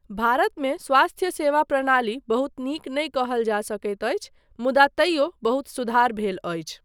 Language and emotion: Maithili, neutral